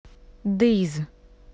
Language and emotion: Russian, neutral